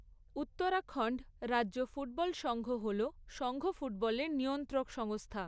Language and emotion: Bengali, neutral